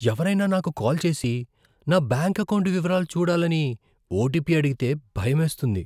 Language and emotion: Telugu, fearful